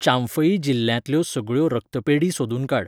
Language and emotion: Goan Konkani, neutral